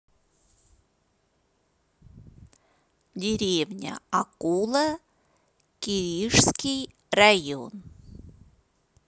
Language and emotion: Russian, neutral